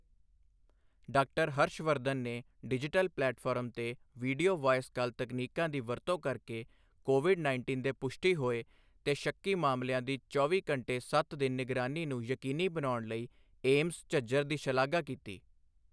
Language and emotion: Punjabi, neutral